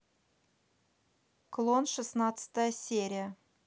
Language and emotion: Russian, neutral